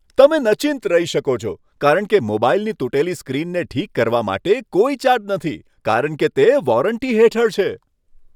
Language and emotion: Gujarati, happy